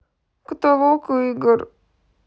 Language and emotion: Russian, sad